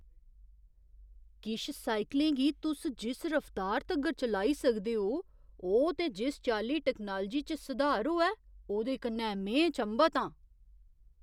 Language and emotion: Dogri, surprised